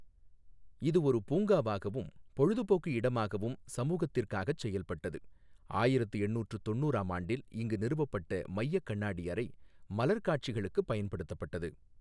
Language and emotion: Tamil, neutral